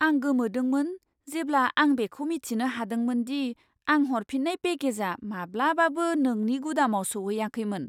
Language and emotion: Bodo, surprised